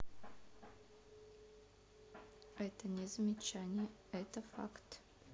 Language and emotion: Russian, neutral